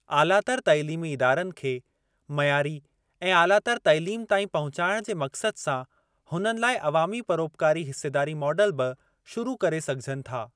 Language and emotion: Sindhi, neutral